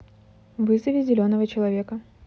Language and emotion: Russian, neutral